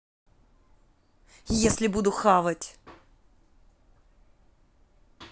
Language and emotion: Russian, angry